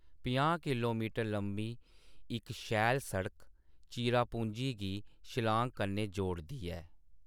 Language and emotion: Dogri, neutral